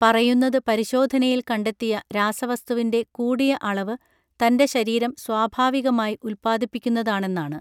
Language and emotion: Malayalam, neutral